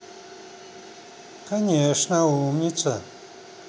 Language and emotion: Russian, positive